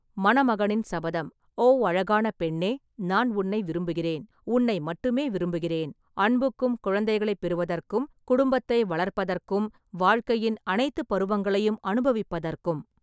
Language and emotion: Tamil, neutral